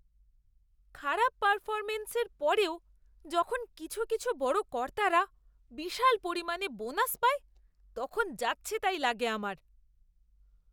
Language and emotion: Bengali, disgusted